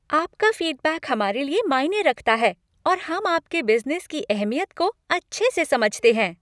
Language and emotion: Hindi, happy